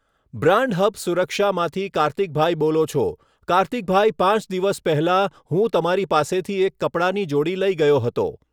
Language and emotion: Gujarati, neutral